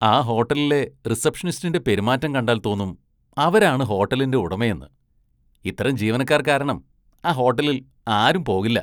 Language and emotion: Malayalam, disgusted